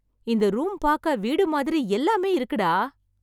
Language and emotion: Tamil, surprised